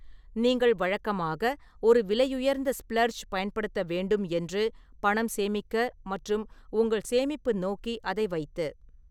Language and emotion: Tamil, neutral